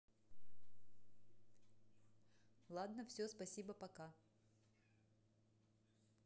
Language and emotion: Russian, neutral